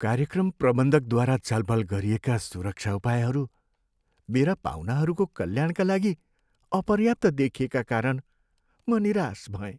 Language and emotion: Nepali, sad